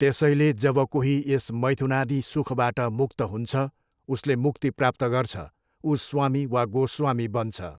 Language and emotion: Nepali, neutral